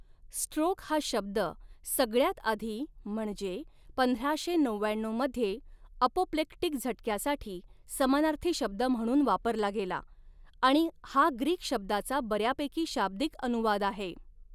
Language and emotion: Marathi, neutral